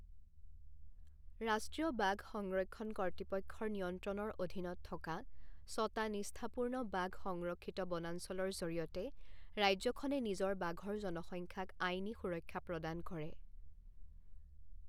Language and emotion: Assamese, neutral